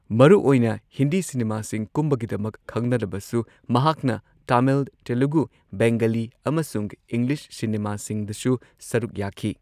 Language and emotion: Manipuri, neutral